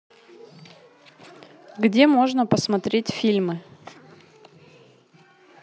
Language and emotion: Russian, neutral